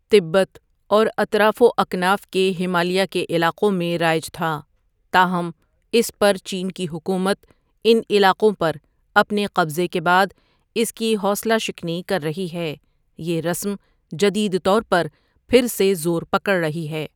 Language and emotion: Urdu, neutral